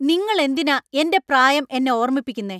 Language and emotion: Malayalam, angry